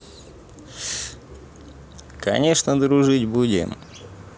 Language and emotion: Russian, positive